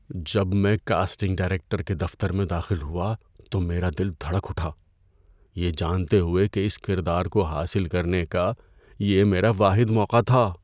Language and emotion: Urdu, fearful